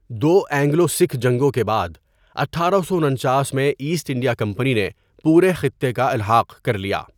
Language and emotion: Urdu, neutral